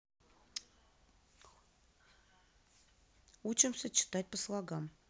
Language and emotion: Russian, neutral